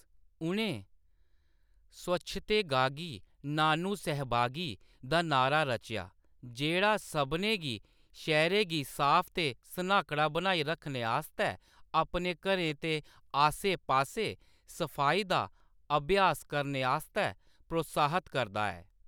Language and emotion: Dogri, neutral